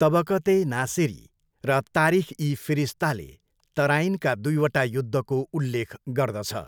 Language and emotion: Nepali, neutral